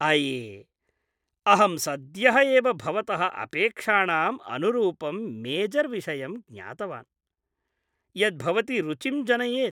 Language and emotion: Sanskrit, happy